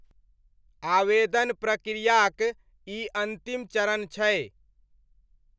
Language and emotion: Maithili, neutral